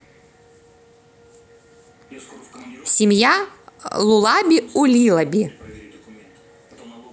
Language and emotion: Russian, neutral